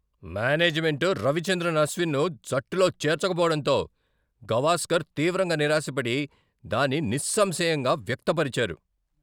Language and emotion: Telugu, angry